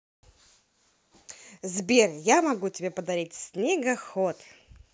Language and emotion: Russian, positive